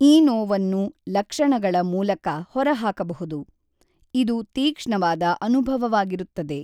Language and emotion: Kannada, neutral